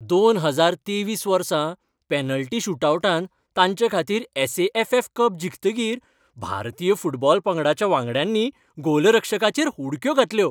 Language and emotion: Goan Konkani, happy